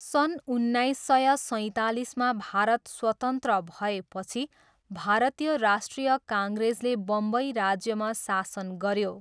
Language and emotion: Nepali, neutral